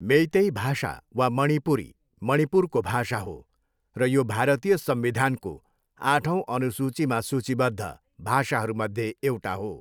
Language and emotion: Nepali, neutral